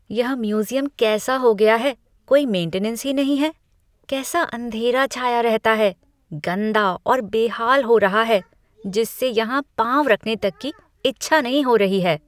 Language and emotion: Hindi, disgusted